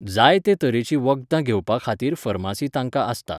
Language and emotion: Goan Konkani, neutral